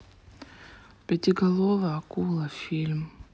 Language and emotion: Russian, sad